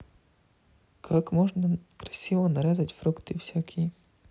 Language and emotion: Russian, neutral